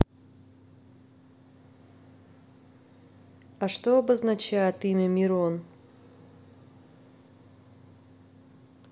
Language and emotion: Russian, neutral